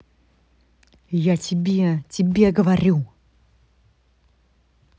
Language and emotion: Russian, angry